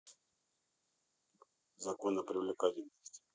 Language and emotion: Russian, neutral